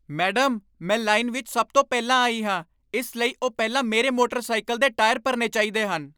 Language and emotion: Punjabi, angry